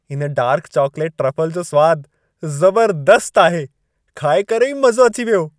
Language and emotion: Sindhi, happy